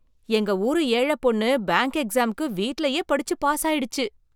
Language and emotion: Tamil, surprised